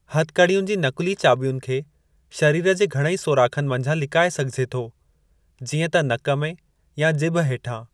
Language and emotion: Sindhi, neutral